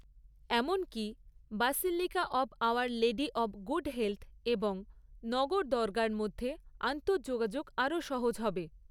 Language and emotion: Bengali, neutral